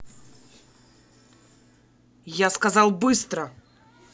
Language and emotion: Russian, angry